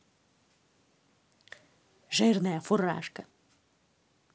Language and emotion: Russian, angry